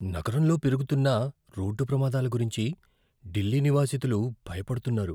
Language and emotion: Telugu, fearful